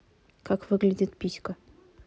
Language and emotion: Russian, neutral